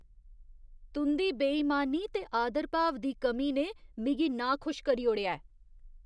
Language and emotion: Dogri, disgusted